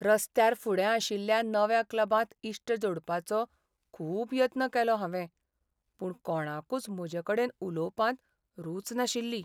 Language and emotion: Goan Konkani, sad